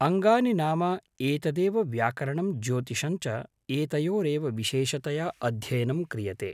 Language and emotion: Sanskrit, neutral